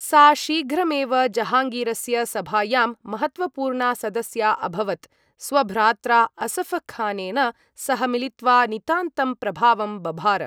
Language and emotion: Sanskrit, neutral